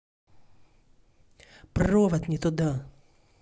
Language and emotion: Russian, angry